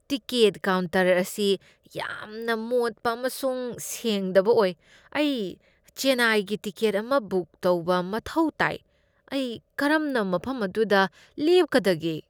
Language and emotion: Manipuri, disgusted